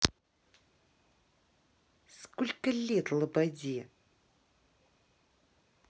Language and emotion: Russian, angry